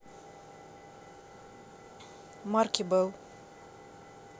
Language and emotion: Russian, neutral